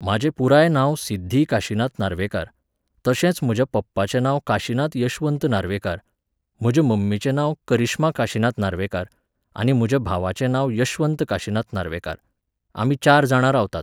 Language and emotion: Goan Konkani, neutral